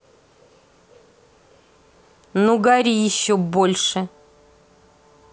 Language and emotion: Russian, angry